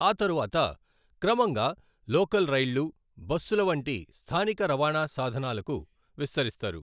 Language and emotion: Telugu, neutral